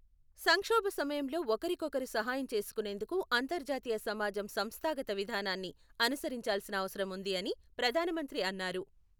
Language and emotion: Telugu, neutral